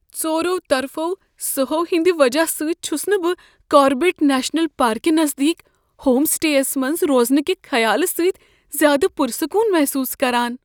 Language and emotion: Kashmiri, fearful